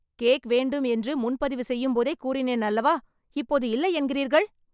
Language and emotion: Tamil, angry